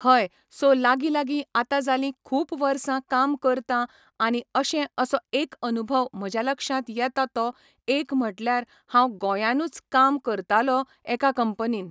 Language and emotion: Goan Konkani, neutral